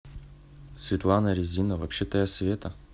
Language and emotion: Russian, neutral